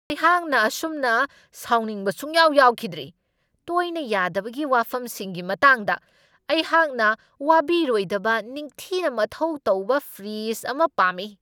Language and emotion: Manipuri, angry